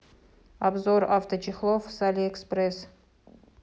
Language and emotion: Russian, neutral